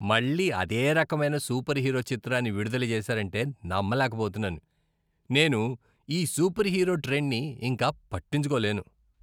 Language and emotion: Telugu, disgusted